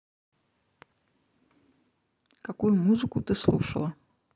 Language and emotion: Russian, neutral